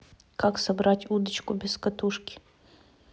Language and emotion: Russian, neutral